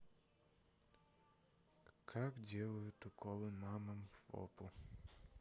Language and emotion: Russian, sad